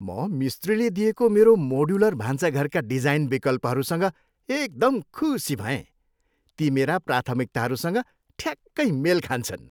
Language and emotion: Nepali, happy